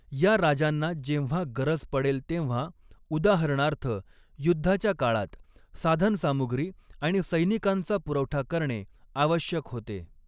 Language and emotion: Marathi, neutral